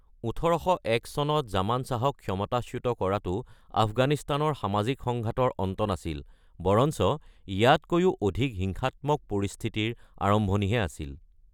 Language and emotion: Assamese, neutral